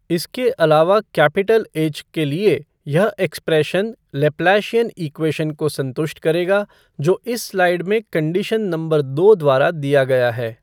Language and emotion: Hindi, neutral